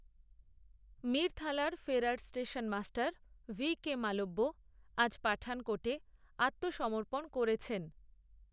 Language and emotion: Bengali, neutral